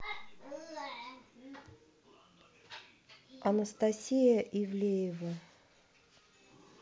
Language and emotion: Russian, neutral